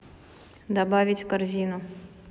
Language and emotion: Russian, neutral